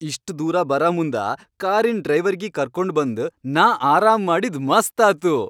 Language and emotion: Kannada, happy